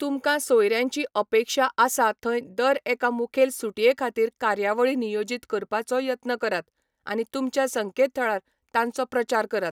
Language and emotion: Goan Konkani, neutral